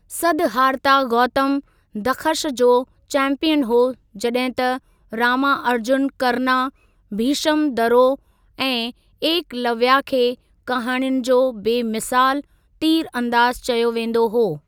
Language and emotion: Sindhi, neutral